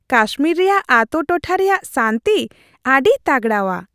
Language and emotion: Santali, happy